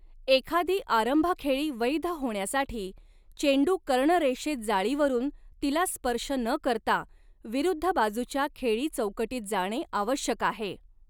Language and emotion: Marathi, neutral